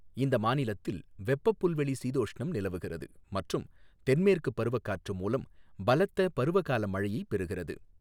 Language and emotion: Tamil, neutral